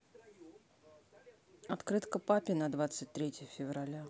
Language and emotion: Russian, neutral